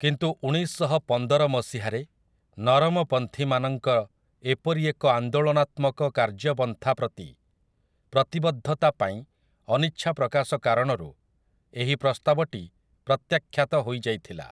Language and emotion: Odia, neutral